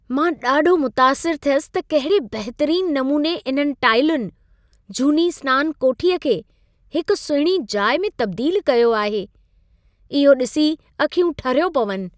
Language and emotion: Sindhi, happy